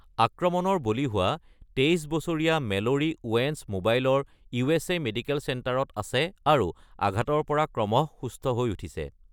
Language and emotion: Assamese, neutral